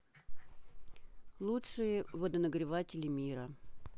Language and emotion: Russian, neutral